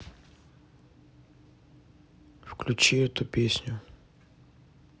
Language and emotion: Russian, neutral